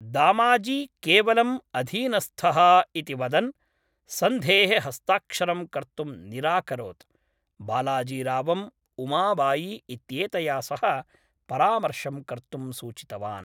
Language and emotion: Sanskrit, neutral